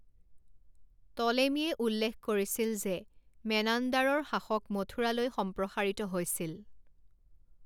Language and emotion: Assamese, neutral